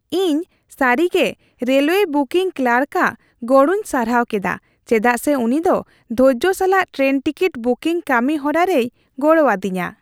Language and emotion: Santali, happy